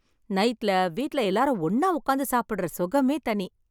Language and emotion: Tamil, happy